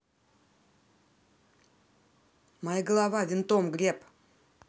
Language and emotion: Russian, angry